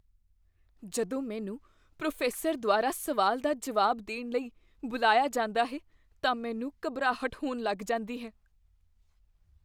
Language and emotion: Punjabi, fearful